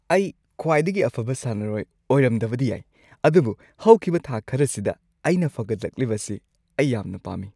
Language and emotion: Manipuri, happy